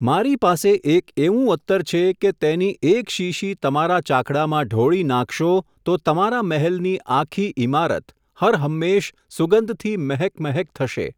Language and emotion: Gujarati, neutral